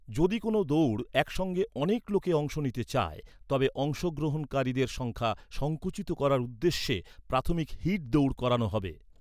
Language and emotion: Bengali, neutral